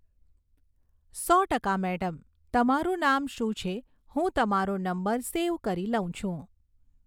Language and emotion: Gujarati, neutral